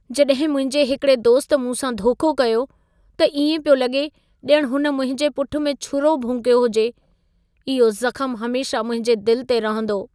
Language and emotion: Sindhi, sad